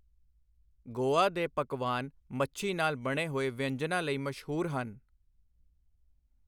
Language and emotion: Punjabi, neutral